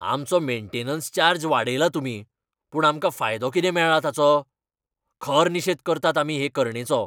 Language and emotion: Goan Konkani, angry